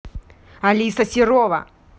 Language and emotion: Russian, angry